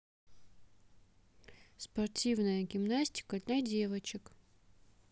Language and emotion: Russian, neutral